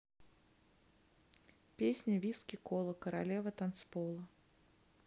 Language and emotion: Russian, neutral